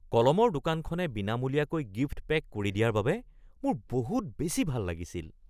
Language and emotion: Assamese, surprised